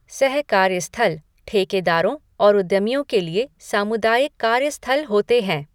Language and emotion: Hindi, neutral